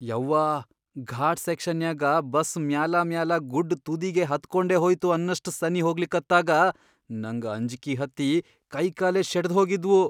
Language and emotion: Kannada, fearful